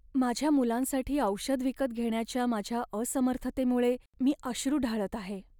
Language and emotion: Marathi, sad